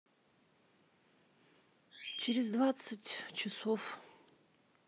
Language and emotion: Russian, sad